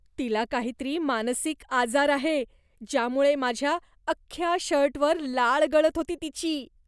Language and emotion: Marathi, disgusted